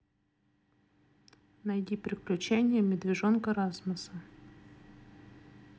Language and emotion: Russian, neutral